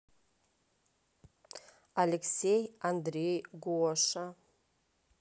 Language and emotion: Russian, neutral